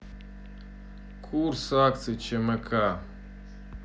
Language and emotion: Russian, neutral